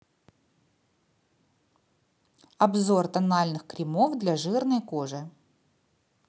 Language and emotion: Russian, neutral